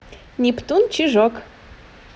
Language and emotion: Russian, positive